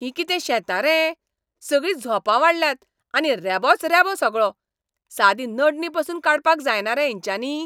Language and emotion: Goan Konkani, angry